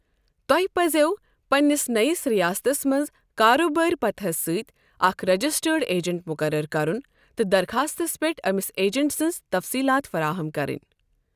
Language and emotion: Kashmiri, neutral